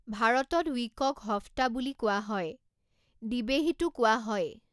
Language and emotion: Assamese, neutral